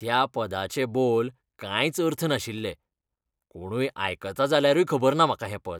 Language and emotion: Goan Konkani, disgusted